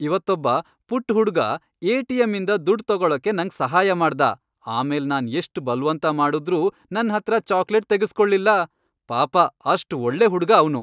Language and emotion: Kannada, happy